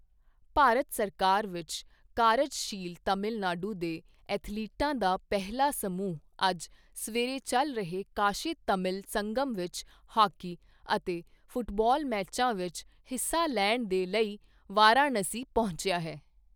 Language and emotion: Punjabi, neutral